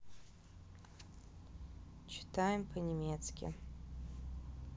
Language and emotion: Russian, neutral